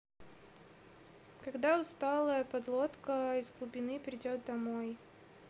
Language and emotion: Russian, neutral